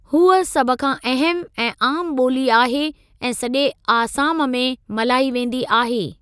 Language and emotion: Sindhi, neutral